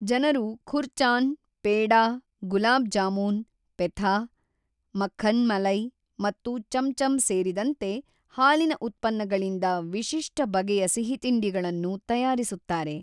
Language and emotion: Kannada, neutral